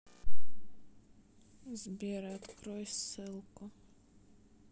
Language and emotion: Russian, neutral